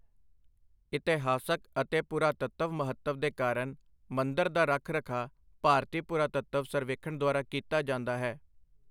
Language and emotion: Punjabi, neutral